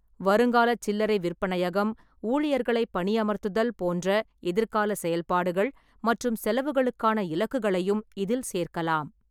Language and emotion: Tamil, neutral